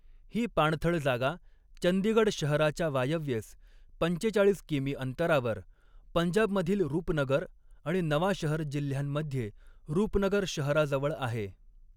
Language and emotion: Marathi, neutral